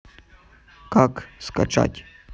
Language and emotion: Russian, neutral